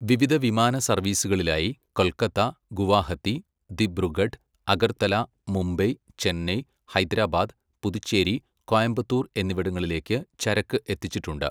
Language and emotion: Malayalam, neutral